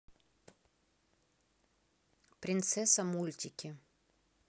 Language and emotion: Russian, neutral